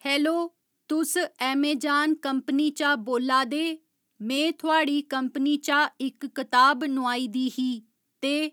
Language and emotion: Dogri, neutral